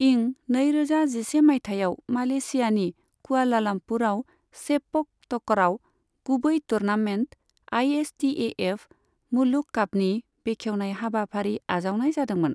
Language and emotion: Bodo, neutral